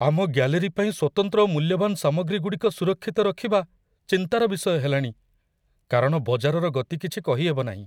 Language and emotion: Odia, fearful